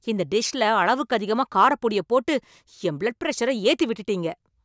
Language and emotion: Tamil, angry